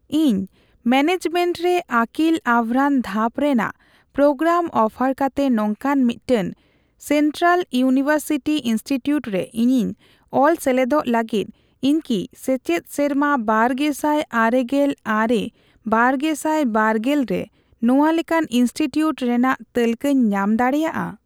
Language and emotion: Santali, neutral